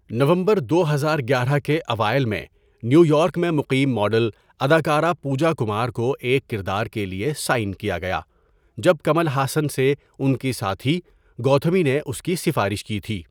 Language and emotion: Urdu, neutral